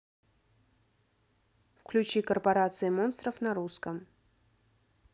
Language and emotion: Russian, neutral